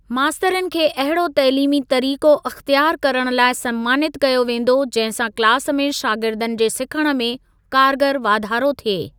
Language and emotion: Sindhi, neutral